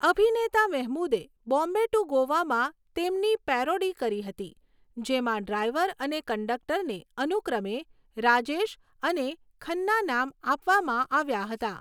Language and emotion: Gujarati, neutral